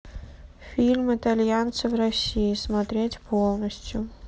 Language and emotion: Russian, neutral